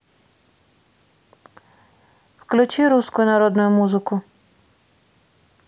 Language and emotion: Russian, neutral